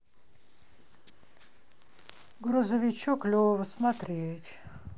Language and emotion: Russian, sad